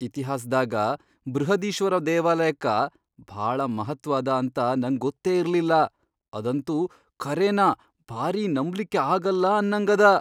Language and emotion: Kannada, surprised